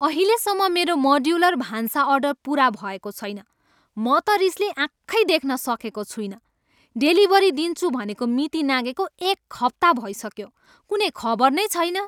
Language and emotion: Nepali, angry